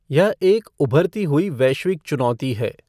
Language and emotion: Hindi, neutral